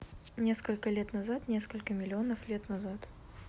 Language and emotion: Russian, neutral